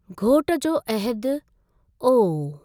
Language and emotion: Sindhi, neutral